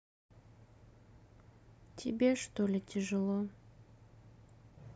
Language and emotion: Russian, sad